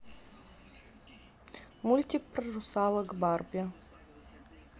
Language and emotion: Russian, neutral